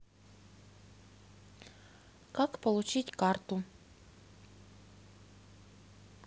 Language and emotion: Russian, neutral